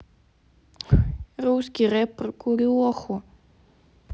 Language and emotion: Russian, neutral